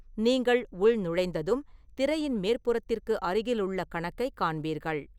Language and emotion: Tamil, neutral